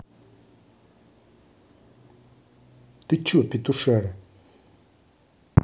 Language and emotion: Russian, angry